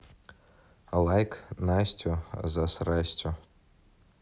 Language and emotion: Russian, neutral